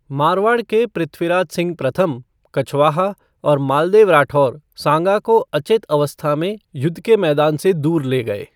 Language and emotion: Hindi, neutral